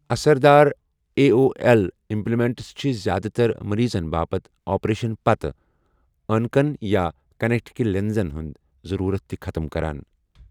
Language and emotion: Kashmiri, neutral